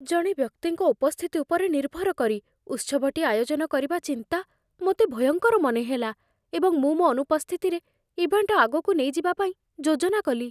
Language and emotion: Odia, fearful